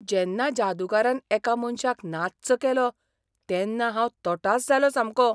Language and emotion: Goan Konkani, surprised